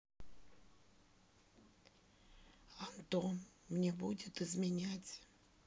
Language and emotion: Russian, sad